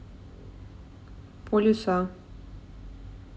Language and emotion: Russian, neutral